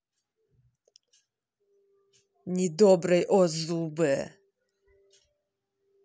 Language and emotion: Russian, angry